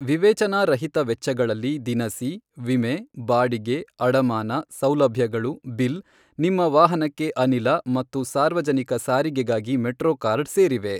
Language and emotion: Kannada, neutral